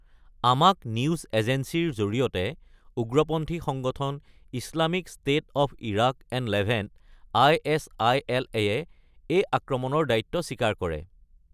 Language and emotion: Assamese, neutral